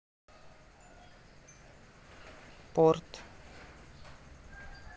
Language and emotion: Russian, neutral